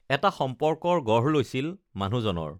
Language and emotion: Assamese, neutral